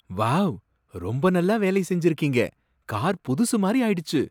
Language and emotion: Tamil, surprised